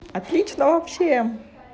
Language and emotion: Russian, positive